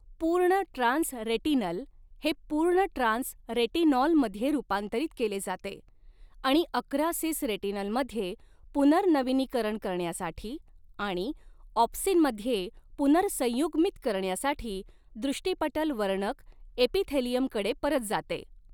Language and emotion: Marathi, neutral